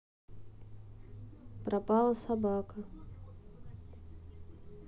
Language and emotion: Russian, sad